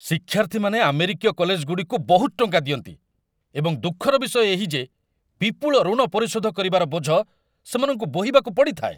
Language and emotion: Odia, angry